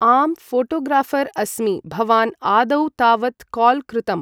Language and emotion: Sanskrit, neutral